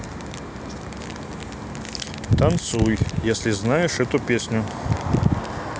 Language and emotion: Russian, neutral